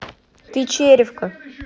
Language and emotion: Russian, angry